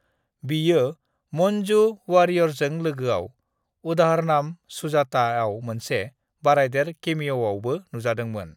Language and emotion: Bodo, neutral